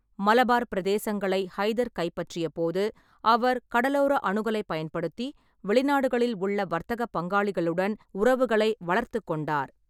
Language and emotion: Tamil, neutral